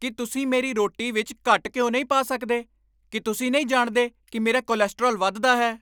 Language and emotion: Punjabi, angry